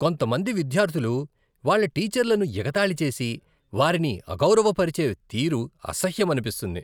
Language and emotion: Telugu, disgusted